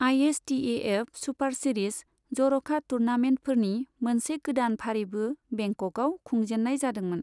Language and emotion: Bodo, neutral